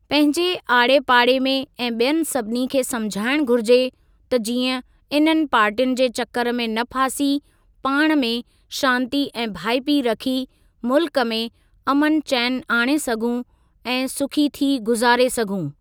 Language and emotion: Sindhi, neutral